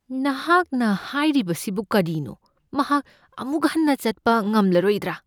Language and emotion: Manipuri, fearful